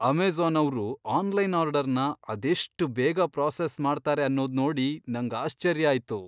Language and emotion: Kannada, surprised